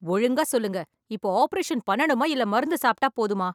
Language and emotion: Tamil, angry